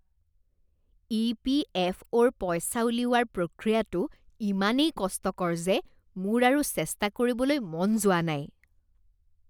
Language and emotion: Assamese, disgusted